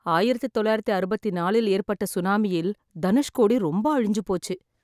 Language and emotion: Tamil, sad